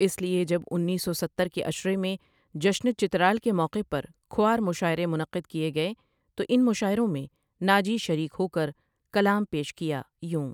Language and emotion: Urdu, neutral